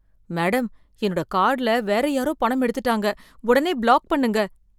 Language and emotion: Tamil, fearful